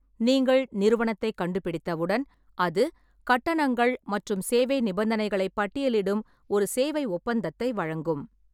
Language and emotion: Tamil, neutral